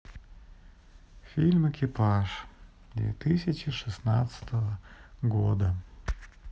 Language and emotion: Russian, sad